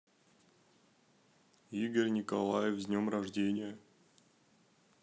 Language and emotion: Russian, neutral